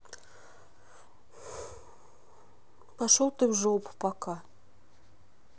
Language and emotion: Russian, neutral